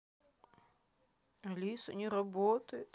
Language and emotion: Russian, sad